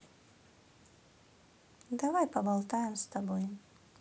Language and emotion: Russian, neutral